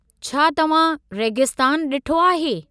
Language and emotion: Sindhi, neutral